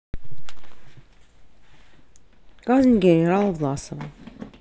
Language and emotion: Russian, neutral